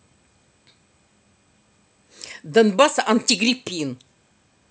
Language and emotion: Russian, angry